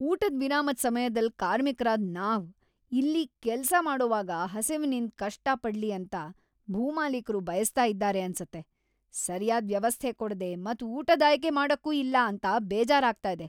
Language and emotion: Kannada, angry